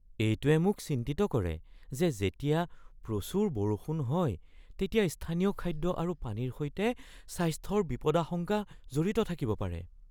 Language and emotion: Assamese, fearful